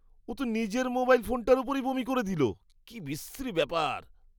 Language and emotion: Bengali, disgusted